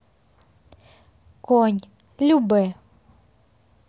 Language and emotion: Russian, neutral